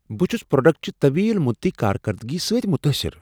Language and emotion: Kashmiri, surprised